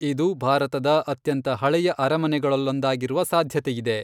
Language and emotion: Kannada, neutral